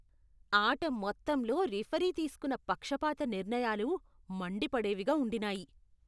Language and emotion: Telugu, disgusted